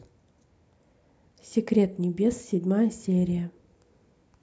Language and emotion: Russian, neutral